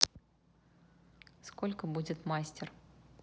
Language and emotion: Russian, neutral